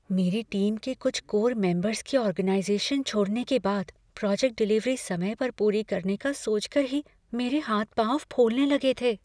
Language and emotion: Hindi, fearful